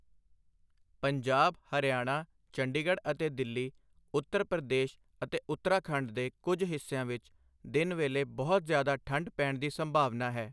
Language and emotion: Punjabi, neutral